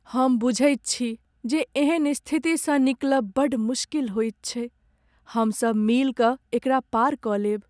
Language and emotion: Maithili, sad